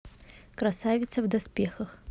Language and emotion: Russian, neutral